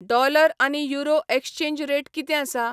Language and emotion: Goan Konkani, neutral